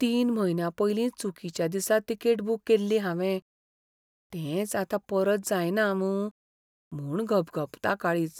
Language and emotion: Goan Konkani, fearful